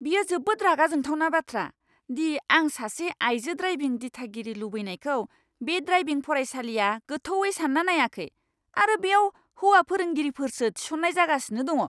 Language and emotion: Bodo, angry